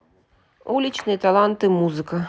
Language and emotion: Russian, neutral